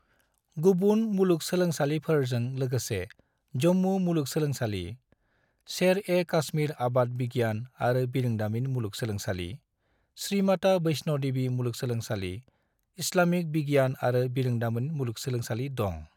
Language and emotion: Bodo, neutral